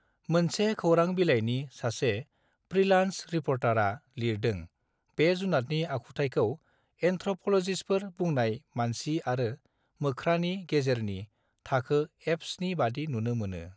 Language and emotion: Bodo, neutral